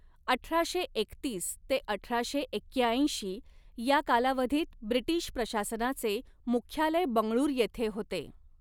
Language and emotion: Marathi, neutral